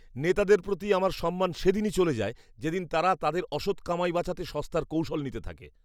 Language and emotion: Bengali, disgusted